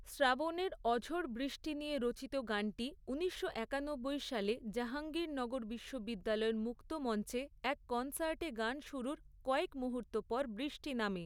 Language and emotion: Bengali, neutral